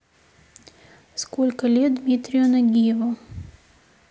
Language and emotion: Russian, neutral